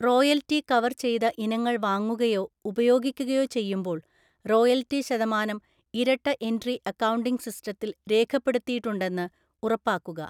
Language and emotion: Malayalam, neutral